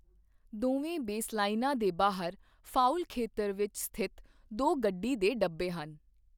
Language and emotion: Punjabi, neutral